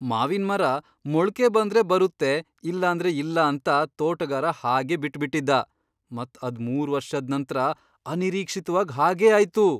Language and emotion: Kannada, surprised